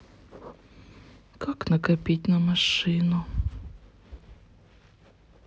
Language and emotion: Russian, sad